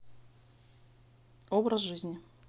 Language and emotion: Russian, neutral